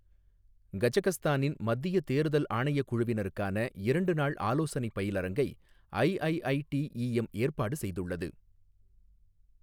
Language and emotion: Tamil, neutral